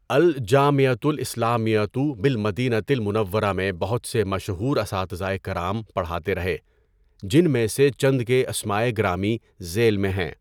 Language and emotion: Urdu, neutral